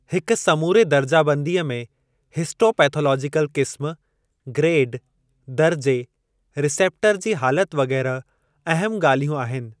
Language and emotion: Sindhi, neutral